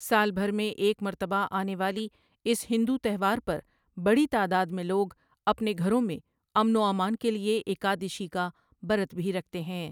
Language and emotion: Urdu, neutral